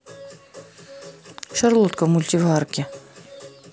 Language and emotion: Russian, neutral